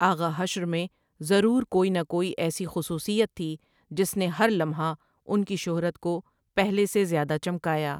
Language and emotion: Urdu, neutral